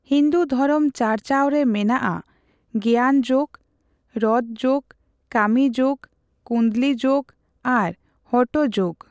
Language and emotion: Santali, neutral